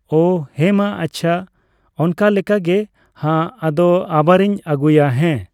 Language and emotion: Santali, neutral